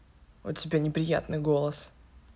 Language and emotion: Russian, angry